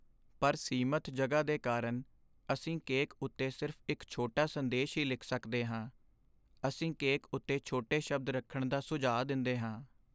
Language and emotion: Punjabi, sad